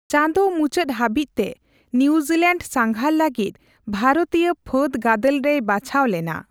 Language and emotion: Santali, neutral